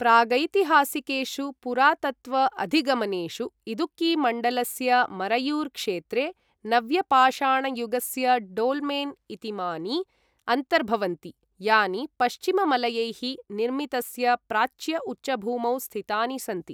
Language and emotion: Sanskrit, neutral